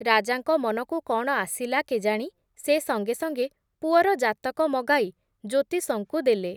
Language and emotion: Odia, neutral